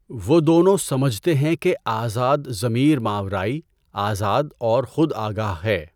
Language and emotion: Urdu, neutral